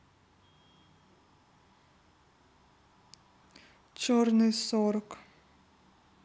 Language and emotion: Russian, neutral